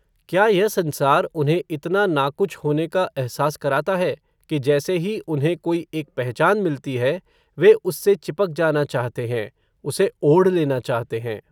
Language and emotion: Hindi, neutral